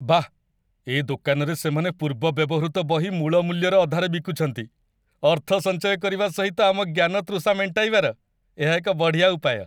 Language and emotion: Odia, happy